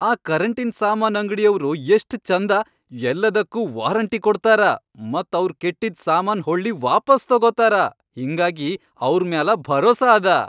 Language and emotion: Kannada, happy